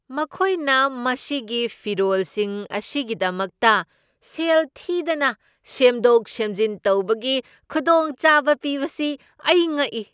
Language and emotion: Manipuri, surprised